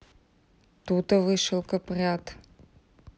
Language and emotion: Russian, neutral